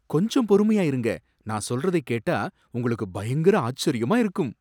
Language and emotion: Tamil, surprised